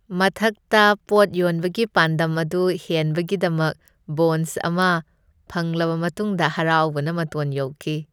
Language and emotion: Manipuri, happy